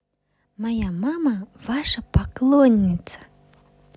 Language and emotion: Russian, positive